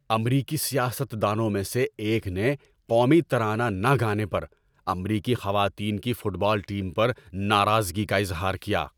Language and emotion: Urdu, angry